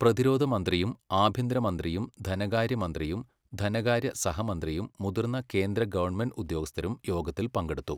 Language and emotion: Malayalam, neutral